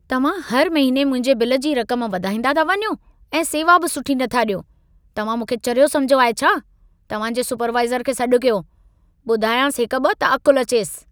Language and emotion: Sindhi, angry